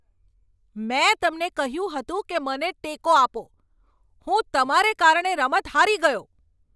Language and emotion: Gujarati, angry